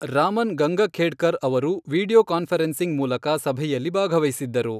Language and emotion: Kannada, neutral